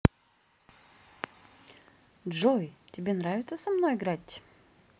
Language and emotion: Russian, positive